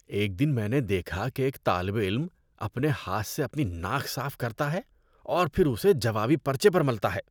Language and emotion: Urdu, disgusted